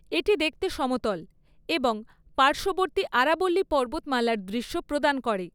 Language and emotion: Bengali, neutral